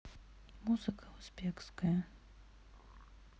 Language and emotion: Russian, sad